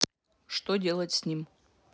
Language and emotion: Russian, neutral